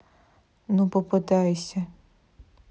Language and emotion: Russian, neutral